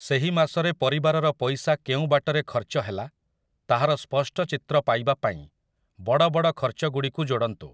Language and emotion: Odia, neutral